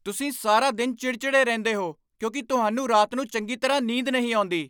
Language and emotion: Punjabi, angry